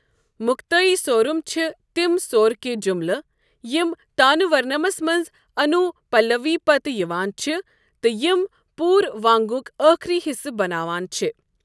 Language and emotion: Kashmiri, neutral